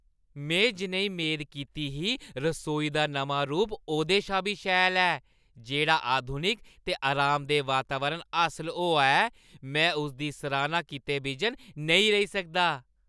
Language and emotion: Dogri, happy